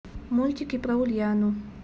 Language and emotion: Russian, neutral